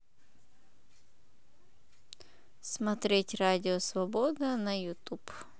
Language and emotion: Russian, neutral